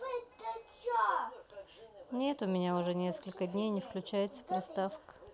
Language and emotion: Russian, sad